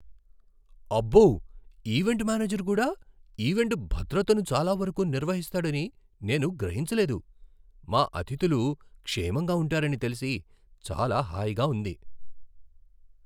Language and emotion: Telugu, surprised